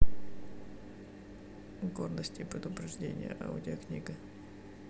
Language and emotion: Russian, neutral